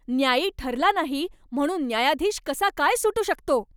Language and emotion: Marathi, angry